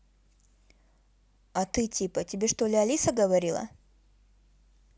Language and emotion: Russian, neutral